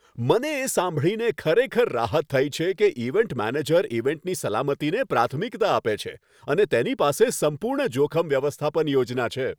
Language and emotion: Gujarati, happy